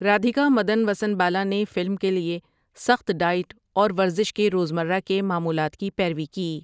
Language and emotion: Urdu, neutral